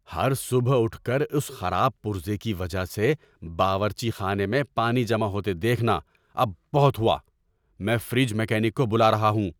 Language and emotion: Urdu, angry